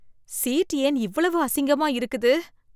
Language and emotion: Tamil, disgusted